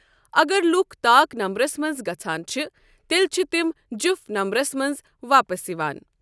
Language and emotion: Kashmiri, neutral